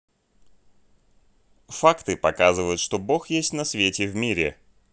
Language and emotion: Russian, neutral